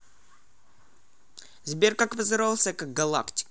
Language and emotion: Russian, neutral